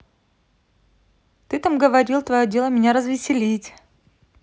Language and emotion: Russian, neutral